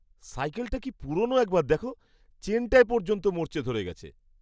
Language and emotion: Bengali, disgusted